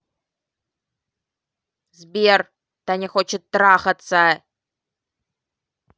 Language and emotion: Russian, angry